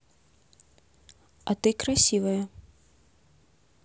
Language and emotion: Russian, neutral